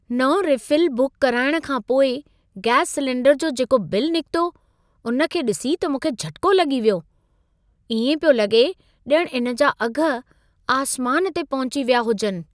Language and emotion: Sindhi, surprised